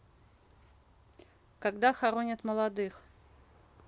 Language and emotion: Russian, neutral